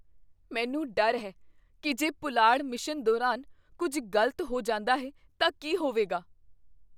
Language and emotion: Punjabi, fearful